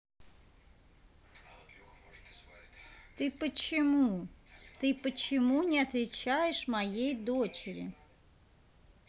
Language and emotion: Russian, neutral